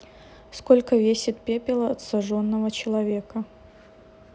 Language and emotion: Russian, neutral